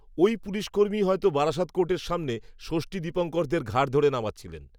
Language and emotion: Bengali, neutral